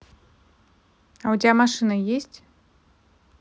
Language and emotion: Russian, neutral